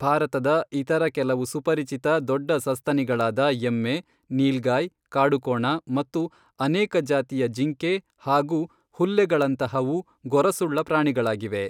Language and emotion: Kannada, neutral